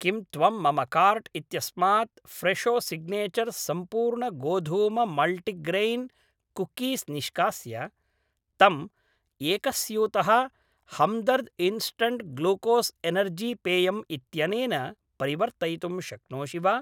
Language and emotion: Sanskrit, neutral